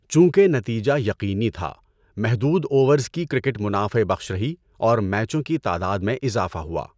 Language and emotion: Urdu, neutral